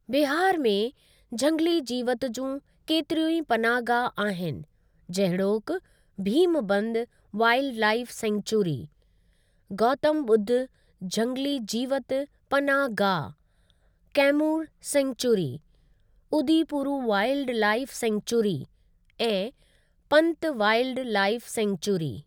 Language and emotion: Sindhi, neutral